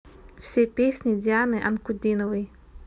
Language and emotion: Russian, neutral